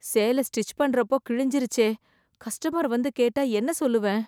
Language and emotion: Tamil, fearful